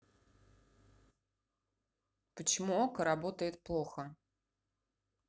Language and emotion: Russian, neutral